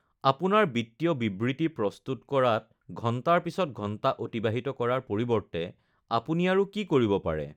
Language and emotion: Assamese, neutral